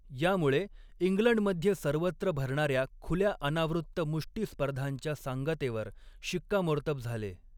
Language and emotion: Marathi, neutral